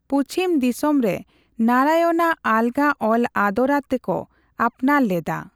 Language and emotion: Santali, neutral